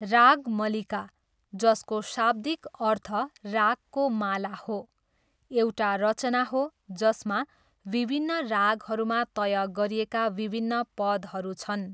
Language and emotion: Nepali, neutral